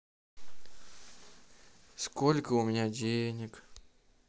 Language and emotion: Russian, sad